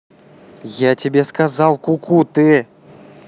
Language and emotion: Russian, angry